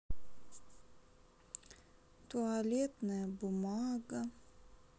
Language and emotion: Russian, sad